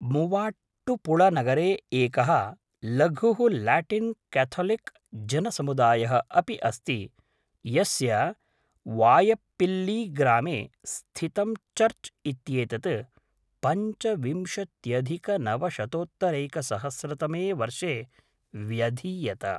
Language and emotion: Sanskrit, neutral